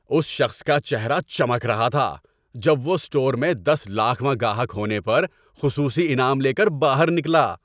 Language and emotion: Urdu, happy